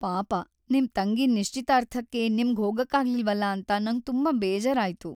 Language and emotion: Kannada, sad